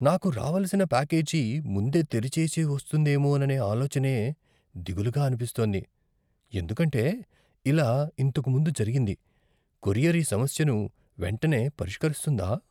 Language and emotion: Telugu, fearful